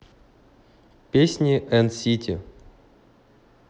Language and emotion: Russian, neutral